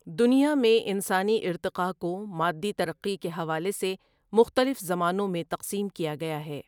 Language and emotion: Urdu, neutral